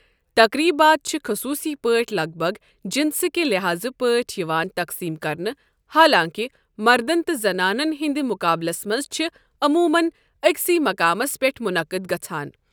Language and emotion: Kashmiri, neutral